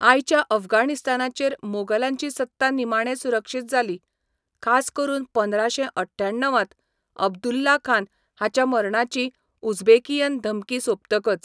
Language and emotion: Goan Konkani, neutral